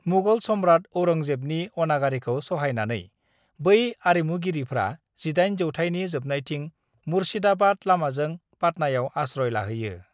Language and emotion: Bodo, neutral